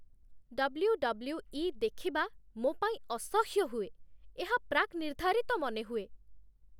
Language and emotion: Odia, disgusted